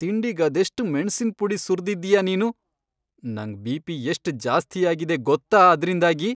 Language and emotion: Kannada, angry